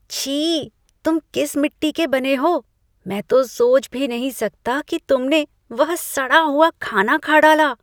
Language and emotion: Hindi, disgusted